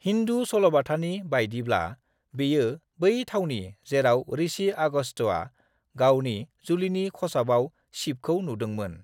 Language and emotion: Bodo, neutral